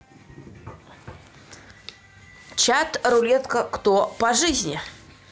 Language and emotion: Russian, neutral